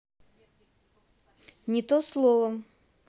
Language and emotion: Russian, neutral